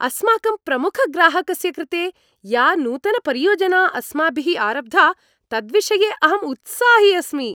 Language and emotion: Sanskrit, happy